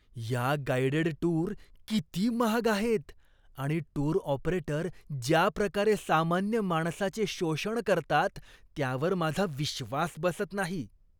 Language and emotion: Marathi, disgusted